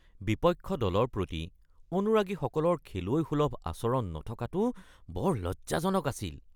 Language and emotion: Assamese, disgusted